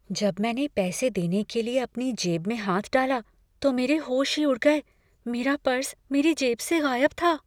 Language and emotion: Hindi, fearful